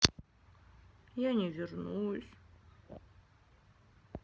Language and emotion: Russian, sad